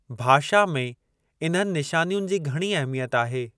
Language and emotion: Sindhi, neutral